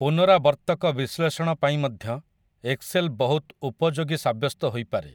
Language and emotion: Odia, neutral